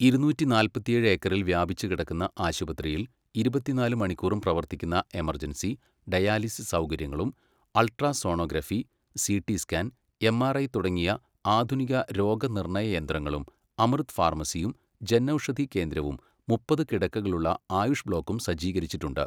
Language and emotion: Malayalam, neutral